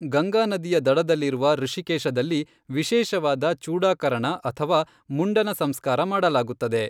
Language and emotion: Kannada, neutral